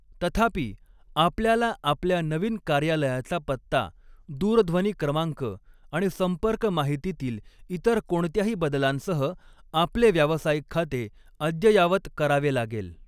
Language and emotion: Marathi, neutral